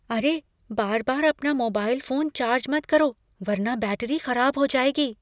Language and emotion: Hindi, fearful